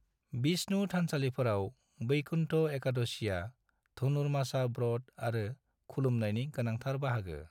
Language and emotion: Bodo, neutral